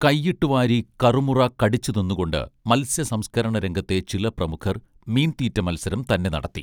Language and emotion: Malayalam, neutral